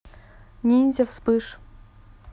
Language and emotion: Russian, neutral